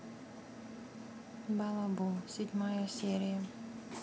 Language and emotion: Russian, sad